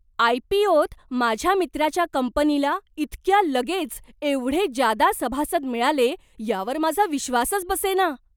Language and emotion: Marathi, surprised